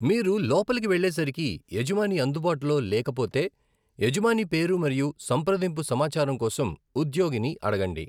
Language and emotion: Telugu, neutral